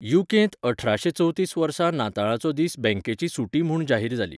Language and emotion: Goan Konkani, neutral